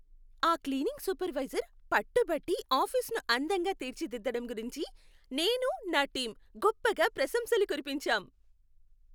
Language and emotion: Telugu, happy